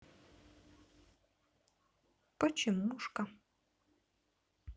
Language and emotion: Russian, neutral